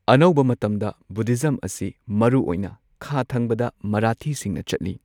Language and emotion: Manipuri, neutral